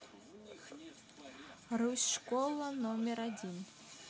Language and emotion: Russian, neutral